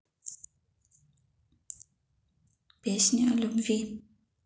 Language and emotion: Russian, neutral